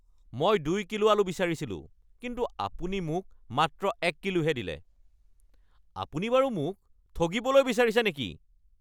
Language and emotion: Assamese, angry